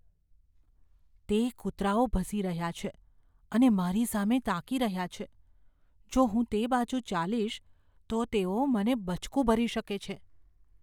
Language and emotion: Gujarati, fearful